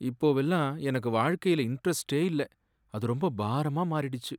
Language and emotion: Tamil, sad